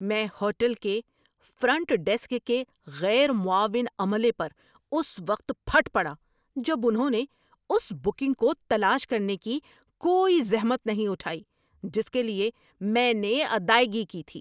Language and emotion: Urdu, angry